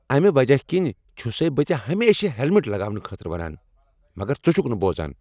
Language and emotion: Kashmiri, angry